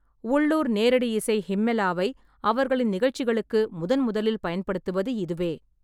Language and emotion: Tamil, neutral